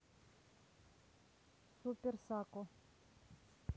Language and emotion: Russian, neutral